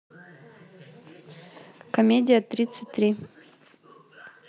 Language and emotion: Russian, neutral